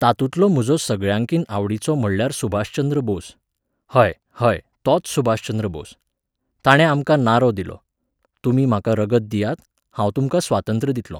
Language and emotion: Goan Konkani, neutral